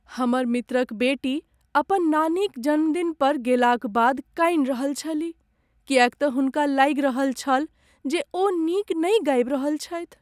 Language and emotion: Maithili, sad